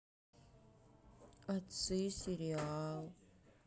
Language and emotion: Russian, sad